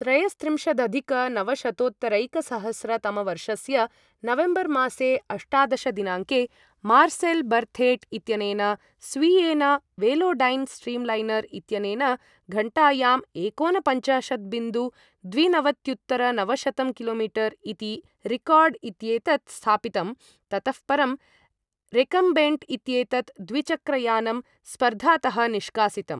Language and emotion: Sanskrit, neutral